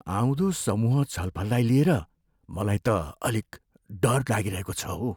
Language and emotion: Nepali, fearful